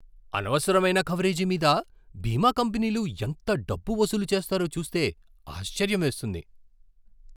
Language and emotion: Telugu, surprised